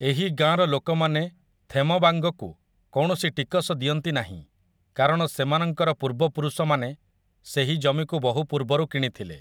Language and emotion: Odia, neutral